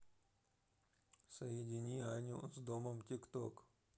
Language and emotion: Russian, neutral